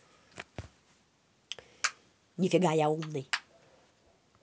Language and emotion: Russian, angry